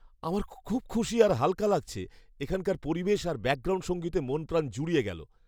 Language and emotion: Bengali, happy